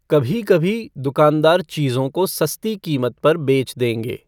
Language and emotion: Hindi, neutral